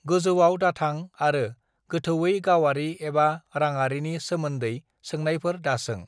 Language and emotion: Bodo, neutral